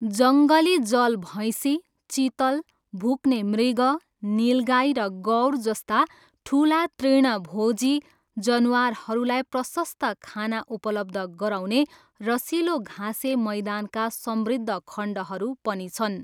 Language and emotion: Nepali, neutral